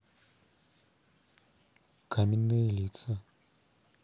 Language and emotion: Russian, neutral